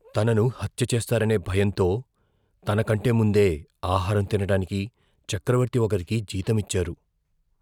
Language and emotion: Telugu, fearful